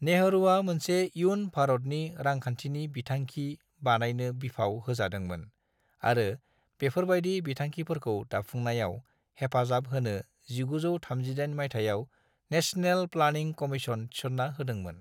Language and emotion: Bodo, neutral